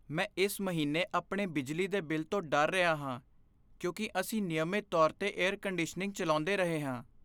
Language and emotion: Punjabi, fearful